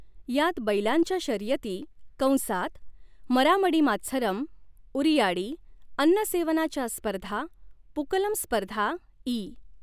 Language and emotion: Marathi, neutral